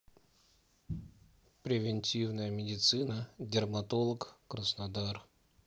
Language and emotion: Russian, neutral